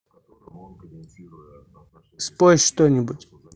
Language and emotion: Russian, neutral